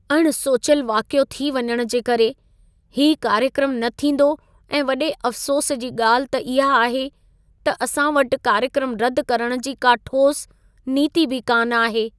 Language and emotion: Sindhi, sad